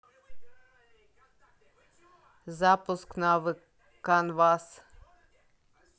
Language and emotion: Russian, neutral